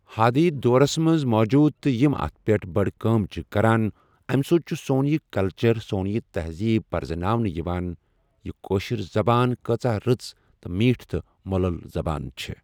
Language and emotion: Kashmiri, neutral